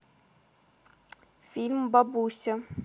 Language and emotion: Russian, neutral